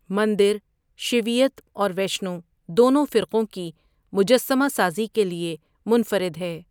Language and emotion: Urdu, neutral